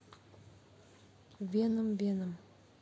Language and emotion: Russian, neutral